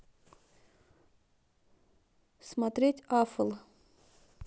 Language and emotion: Russian, neutral